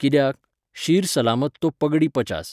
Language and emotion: Goan Konkani, neutral